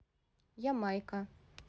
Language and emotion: Russian, neutral